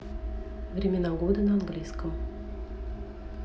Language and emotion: Russian, neutral